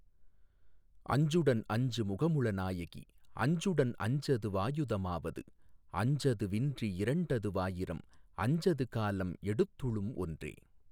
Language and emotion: Tamil, neutral